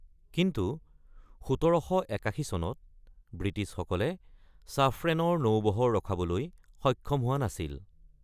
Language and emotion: Assamese, neutral